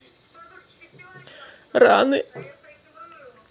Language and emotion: Russian, sad